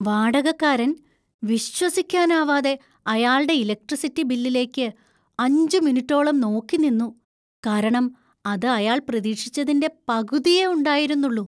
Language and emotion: Malayalam, surprised